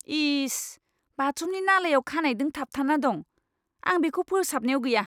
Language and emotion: Bodo, disgusted